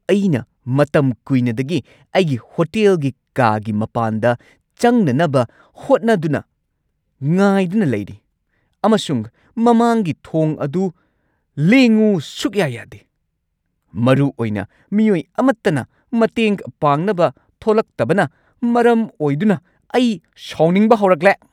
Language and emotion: Manipuri, angry